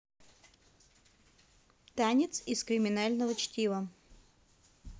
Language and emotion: Russian, neutral